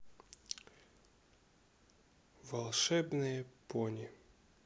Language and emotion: Russian, neutral